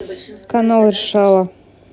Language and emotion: Russian, neutral